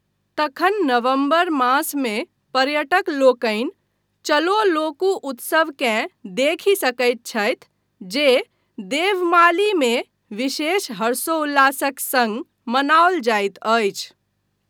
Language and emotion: Maithili, neutral